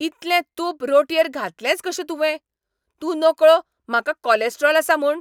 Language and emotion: Goan Konkani, angry